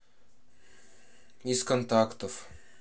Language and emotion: Russian, neutral